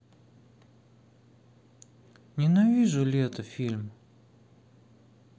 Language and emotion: Russian, sad